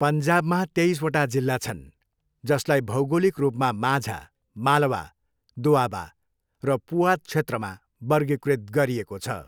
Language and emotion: Nepali, neutral